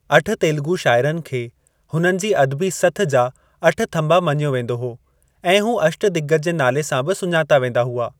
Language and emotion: Sindhi, neutral